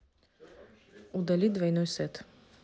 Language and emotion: Russian, neutral